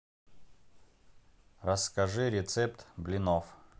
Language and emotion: Russian, neutral